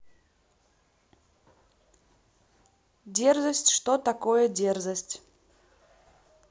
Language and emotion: Russian, neutral